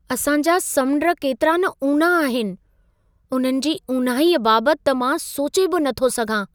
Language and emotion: Sindhi, surprised